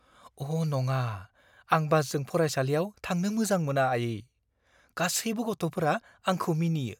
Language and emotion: Bodo, fearful